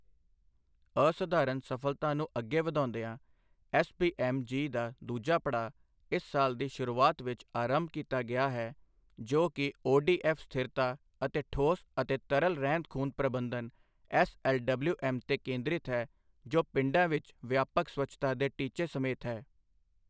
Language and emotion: Punjabi, neutral